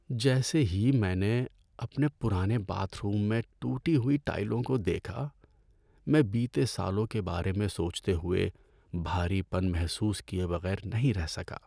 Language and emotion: Urdu, sad